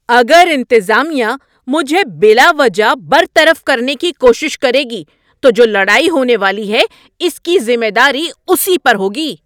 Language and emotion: Urdu, angry